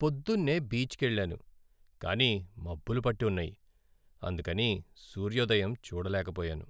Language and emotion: Telugu, sad